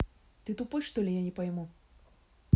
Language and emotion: Russian, angry